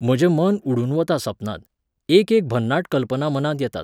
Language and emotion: Goan Konkani, neutral